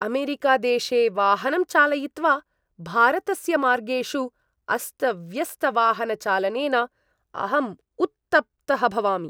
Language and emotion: Sanskrit, disgusted